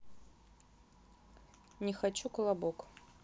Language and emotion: Russian, neutral